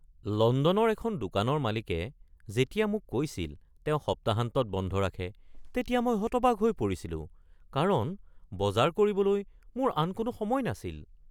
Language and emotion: Assamese, surprised